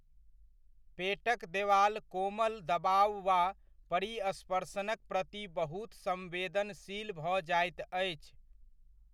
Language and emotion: Maithili, neutral